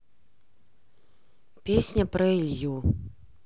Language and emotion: Russian, neutral